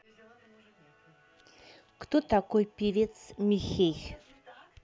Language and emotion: Russian, neutral